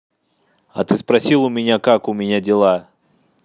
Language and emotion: Russian, angry